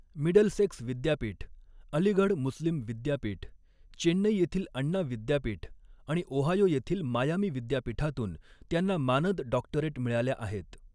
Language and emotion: Marathi, neutral